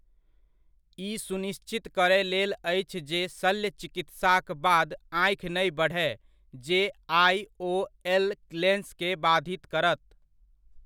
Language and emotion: Maithili, neutral